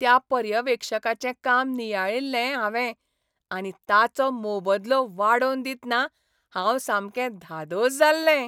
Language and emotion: Goan Konkani, happy